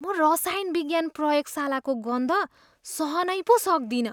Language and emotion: Nepali, disgusted